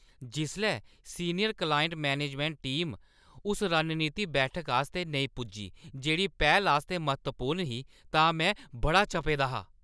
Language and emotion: Dogri, angry